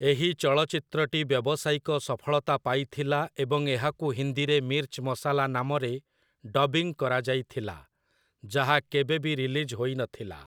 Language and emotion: Odia, neutral